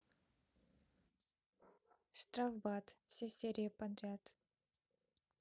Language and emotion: Russian, neutral